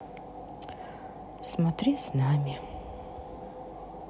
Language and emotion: Russian, sad